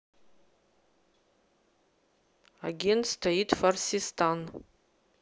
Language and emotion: Russian, neutral